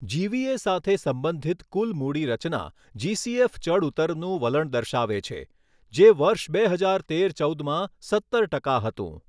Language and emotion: Gujarati, neutral